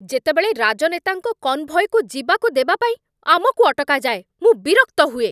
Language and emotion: Odia, angry